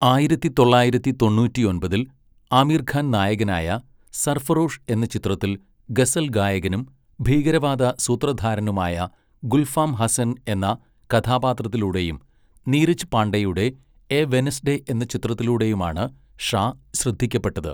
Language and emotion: Malayalam, neutral